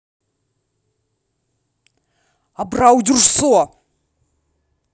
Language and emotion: Russian, angry